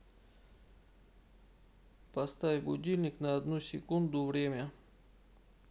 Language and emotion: Russian, neutral